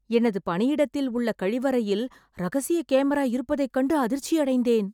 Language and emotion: Tamil, surprised